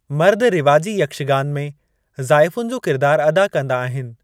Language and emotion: Sindhi, neutral